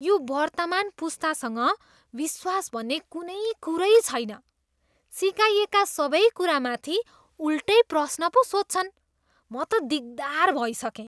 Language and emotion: Nepali, disgusted